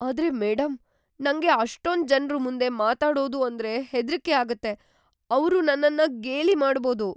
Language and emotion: Kannada, fearful